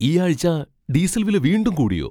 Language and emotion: Malayalam, surprised